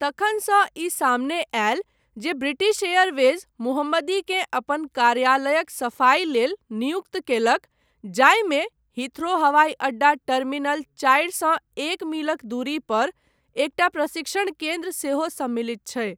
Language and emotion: Maithili, neutral